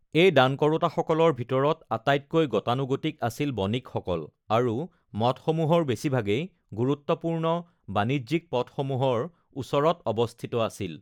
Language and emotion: Assamese, neutral